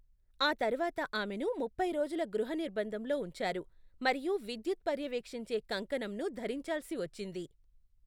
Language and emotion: Telugu, neutral